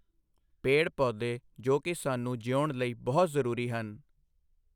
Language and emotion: Punjabi, neutral